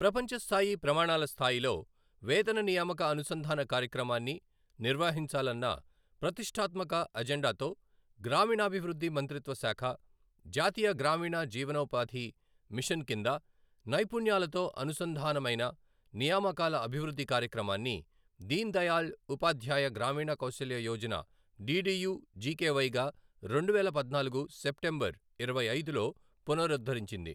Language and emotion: Telugu, neutral